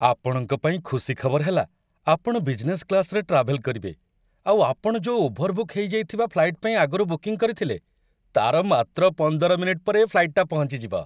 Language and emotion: Odia, happy